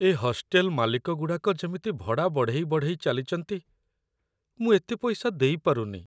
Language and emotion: Odia, sad